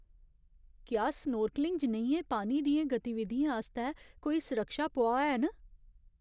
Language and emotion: Dogri, fearful